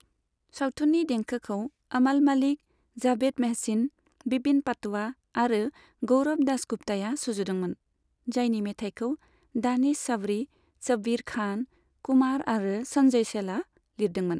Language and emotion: Bodo, neutral